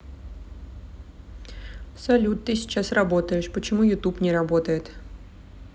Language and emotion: Russian, neutral